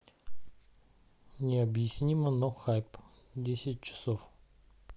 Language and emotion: Russian, neutral